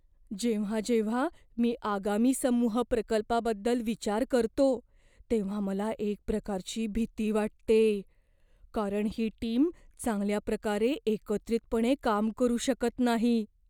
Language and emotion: Marathi, fearful